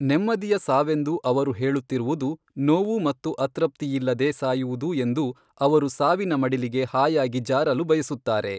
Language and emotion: Kannada, neutral